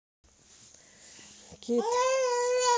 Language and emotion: Russian, neutral